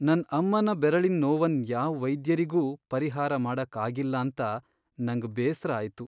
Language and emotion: Kannada, sad